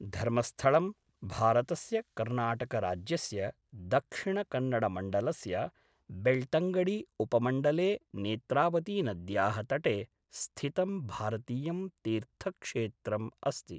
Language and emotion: Sanskrit, neutral